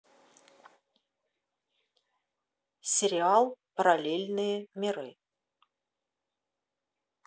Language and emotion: Russian, neutral